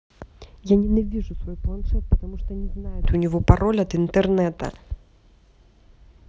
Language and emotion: Russian, angry